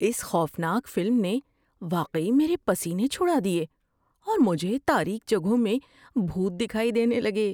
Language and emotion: Urdu, fearful